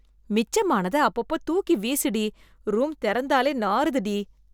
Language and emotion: Tamil, disgusted